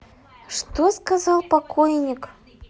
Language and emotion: Russian, neutral